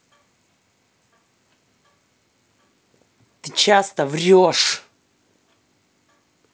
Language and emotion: Russian, angry